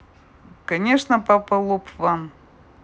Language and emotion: Russian, neutral